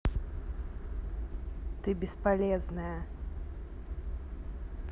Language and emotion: Russian, sad